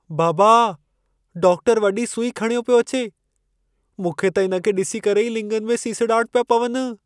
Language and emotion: Sindhi, fearful